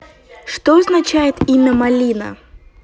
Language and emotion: Russian, neutral